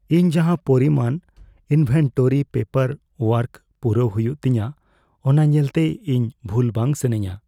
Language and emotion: Santali, fearful